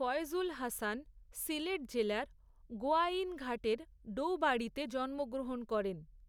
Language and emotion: Bengali, neutral